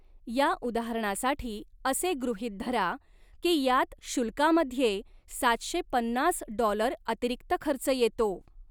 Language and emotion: Marathi, neutral